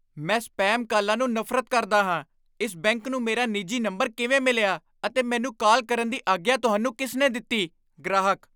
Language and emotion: Punjabi, angry